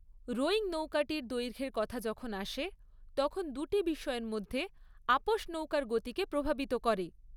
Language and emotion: Bengali, neutral